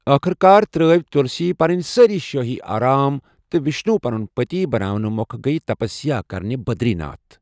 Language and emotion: Kashmiri, neutral